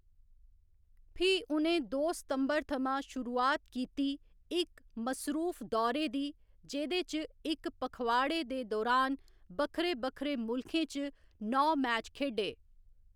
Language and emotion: Dogri, neutral